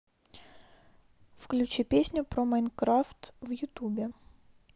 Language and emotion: Russian, neutral